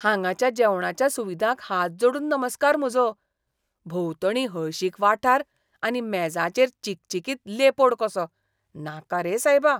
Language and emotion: Goan Konkani, disgusted